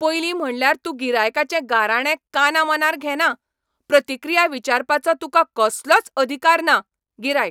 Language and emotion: Goan Konkani, angry